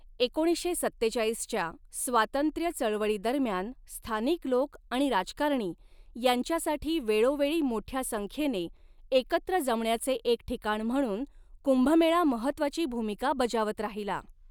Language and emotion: Marathi, neutral